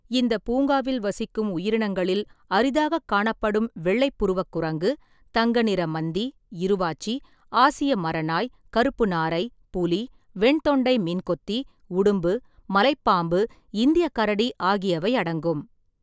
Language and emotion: Tamil, neutral